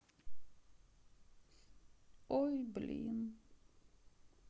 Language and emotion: Russian, sad